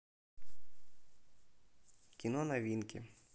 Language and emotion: Russian, neutral